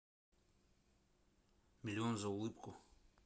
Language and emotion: Russian, neutral